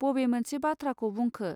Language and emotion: Bodo, neutral